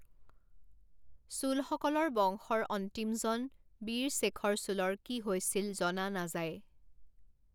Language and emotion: Assamese, neutral